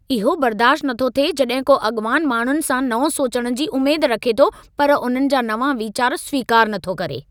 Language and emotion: Sindhi, angry